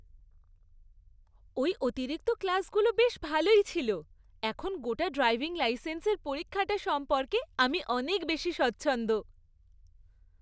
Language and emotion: Bengali, happy